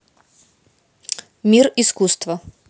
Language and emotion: Russian, positive